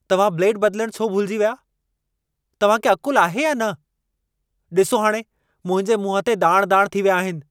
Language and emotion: Sindhi, angry